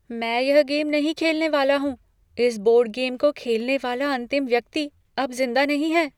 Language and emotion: Hindi, fearful